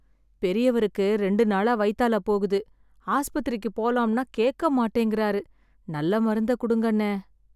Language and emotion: Tamil, sad